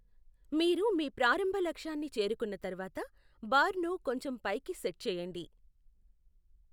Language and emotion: Telugu, neutral